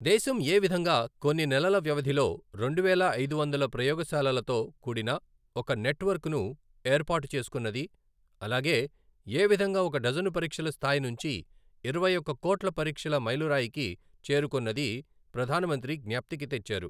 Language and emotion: Telugu, neutral